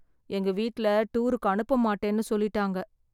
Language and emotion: Tamil, sad